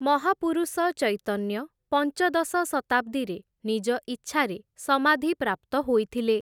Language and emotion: Odia, neutral